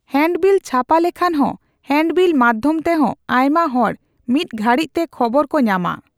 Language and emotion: Santali, neutral